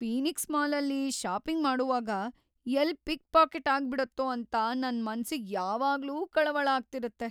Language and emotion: Kannada, fearful